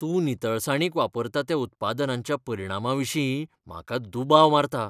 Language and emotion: Goan Konkani, fearful